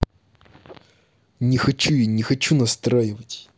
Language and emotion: Russian, angry